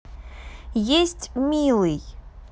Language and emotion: Russian, neutral